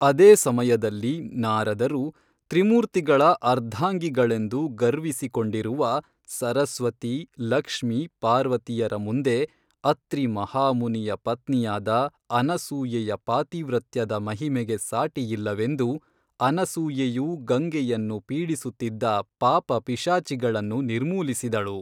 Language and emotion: Kannada, neutral